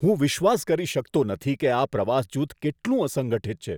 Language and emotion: Gujarati, disgusted